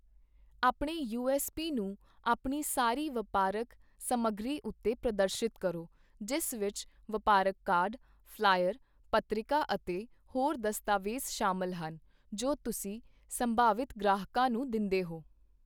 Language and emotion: Punjabi, neutral